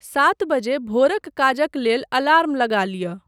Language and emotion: Maithili, neutral